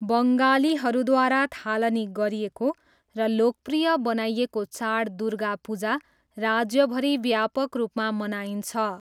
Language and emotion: Nepali, neutral